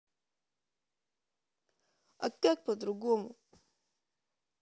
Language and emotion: Russian, sad